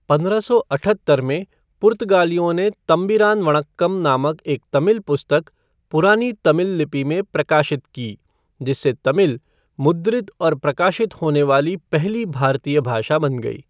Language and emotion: Hindi, neutral